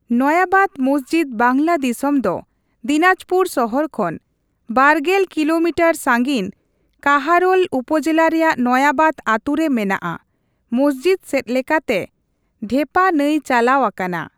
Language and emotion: Santali, neutral